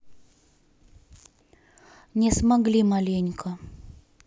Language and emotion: Russian, neutral